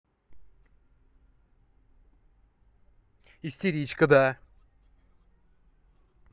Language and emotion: Russian, angry